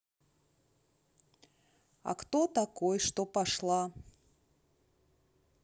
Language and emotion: Russian, neutral